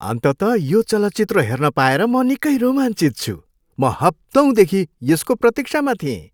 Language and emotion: Nepali, happy